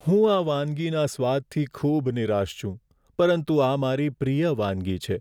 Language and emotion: Gujarati, sad